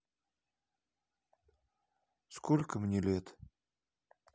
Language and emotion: Russian, sad